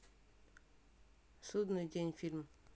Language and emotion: Russian, neutral